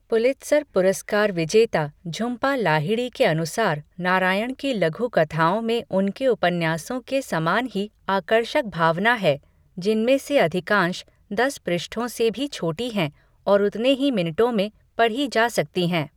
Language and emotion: Hindi, neutral